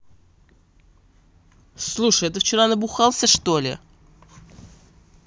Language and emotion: Russian, angry